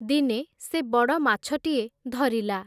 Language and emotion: Odia, neutral